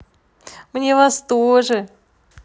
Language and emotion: Russian, positive